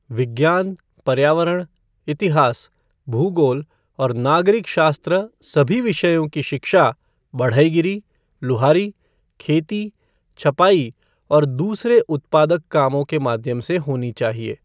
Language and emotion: Hindi, neutral